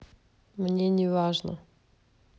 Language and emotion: Russian, neutral